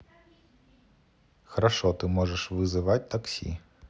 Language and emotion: Russian, neutral